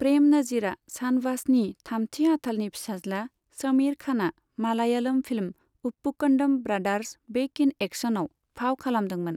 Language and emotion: Bodo, neutral